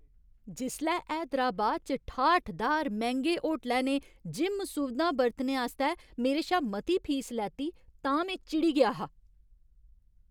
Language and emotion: Dogri, angry